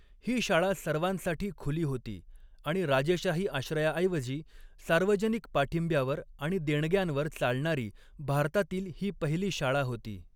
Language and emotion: Marathi, neutral